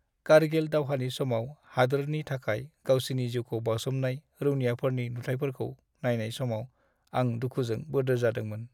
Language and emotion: Bodo, sad